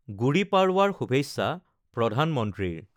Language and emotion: Assamese, neutral